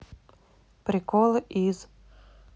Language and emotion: Russian, neutral